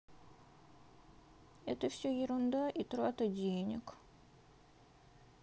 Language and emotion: Russian, sad